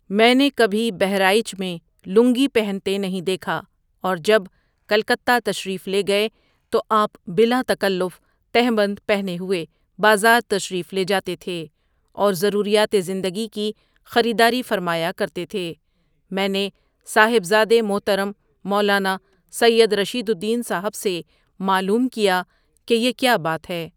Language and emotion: Urdu, neutral